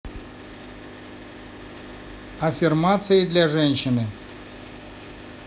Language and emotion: Russian, neutral